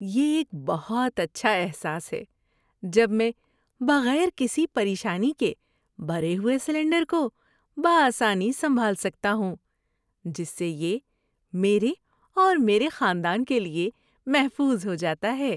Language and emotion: Urdu, happy